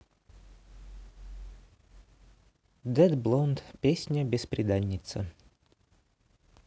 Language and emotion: Russian, neutral